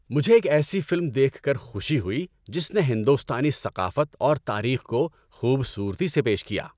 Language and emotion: Urdu, happy